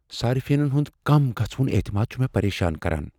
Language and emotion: Kashmiri, fearful